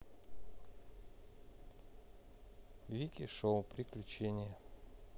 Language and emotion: Russian, neutral